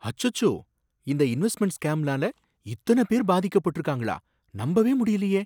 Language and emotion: Tamil, surprised